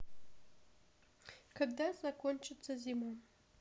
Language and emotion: Russian, sad